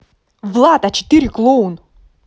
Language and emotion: Russian, angry